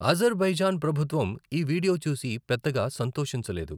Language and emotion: Telugu, neutral